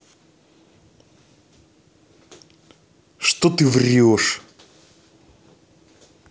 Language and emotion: Russian, angry